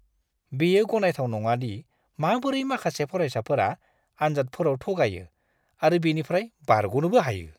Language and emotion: Bodo, disgusted